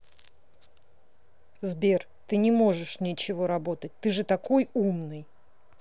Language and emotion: Russian, angry